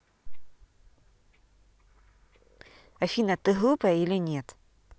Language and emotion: Russian, neutral